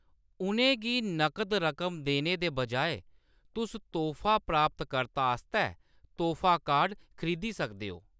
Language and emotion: Dogri, neutral